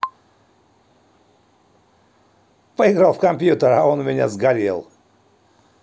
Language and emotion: Russian, neutral